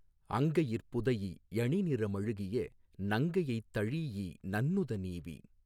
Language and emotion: Tamil, neutral